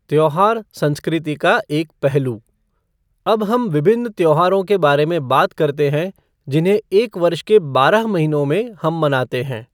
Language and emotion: Hindi, neutral